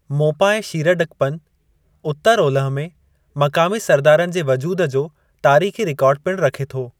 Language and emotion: Sindhi, neutral